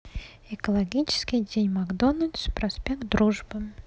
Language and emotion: Russian, neutral